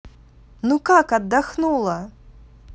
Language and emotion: Russian, positive